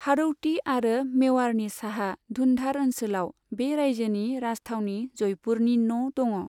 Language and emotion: Bodo, neutral